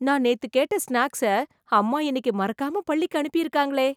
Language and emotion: Tamil, surprised